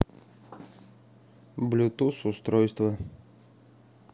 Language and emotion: Russian, neutral